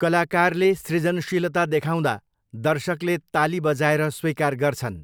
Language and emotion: Nepali, neutral